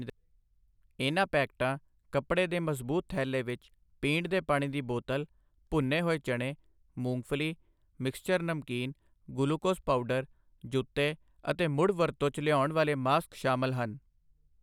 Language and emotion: Punjabi, neutral